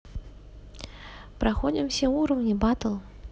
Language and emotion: Russian, neutral